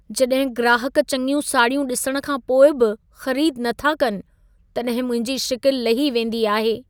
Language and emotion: Sindhi, sad